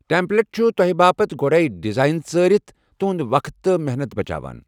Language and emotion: Kashmiri, neutral